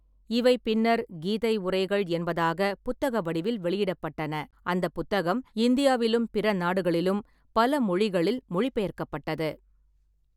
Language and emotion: Tamil, neutral